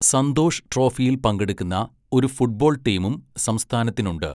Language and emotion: Malayalam, neutral